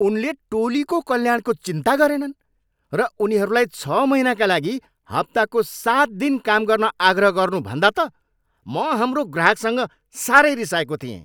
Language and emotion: Nepali, angry